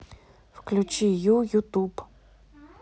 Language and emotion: Russian, neutral